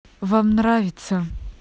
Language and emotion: Russian, neutral